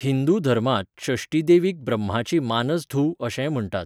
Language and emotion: Goan Konkani, neutral